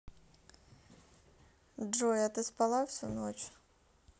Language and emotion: Russian, neutral